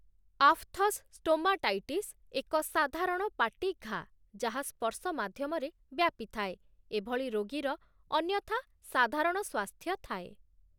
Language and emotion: Odia, neutral